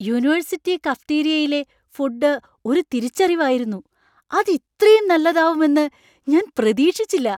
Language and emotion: Malayalam, surprised